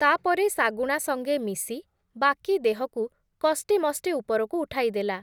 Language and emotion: Odia, neutral